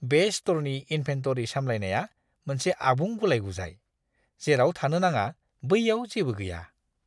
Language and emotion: Bodo, disgusted